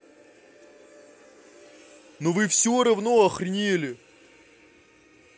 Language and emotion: Russian, angry